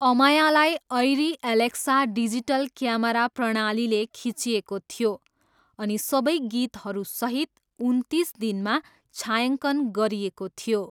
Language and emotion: Nepali, neutral